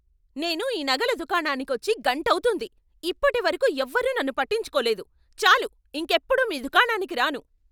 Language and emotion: Telugu, angry